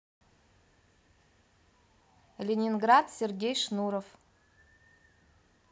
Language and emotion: Russian, positive